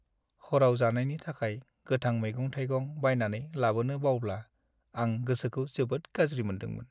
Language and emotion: Bodo, sad